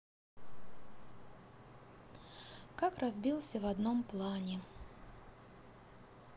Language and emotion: Russian, sad